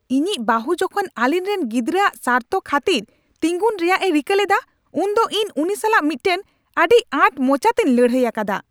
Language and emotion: Santali, angry